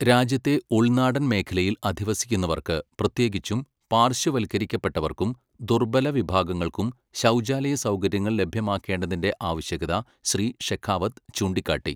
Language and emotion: Malayalam, neutral